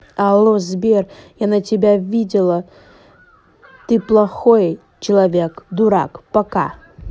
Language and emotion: Russian, angry